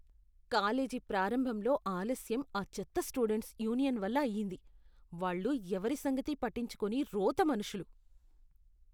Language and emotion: Telugu, disgusted